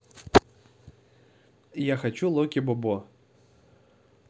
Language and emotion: Russian, neutral